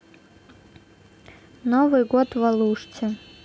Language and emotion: Russian, neutral